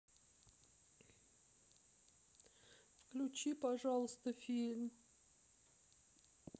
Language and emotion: Russian, sad